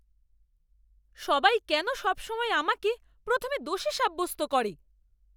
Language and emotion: Bengali, angry